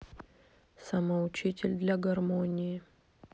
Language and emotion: Russian, neutral